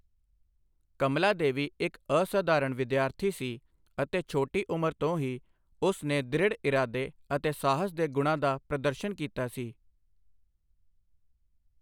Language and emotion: Punjabi, neutral